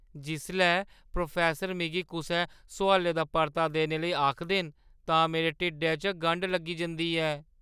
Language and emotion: Dogri, fearful